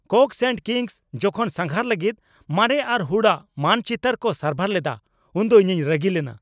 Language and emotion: Santali, angry